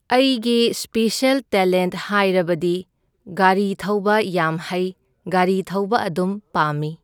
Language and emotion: Manipuri, neutral